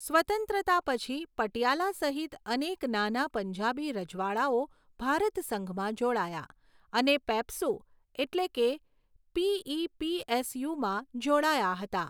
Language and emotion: Gujarati, neutral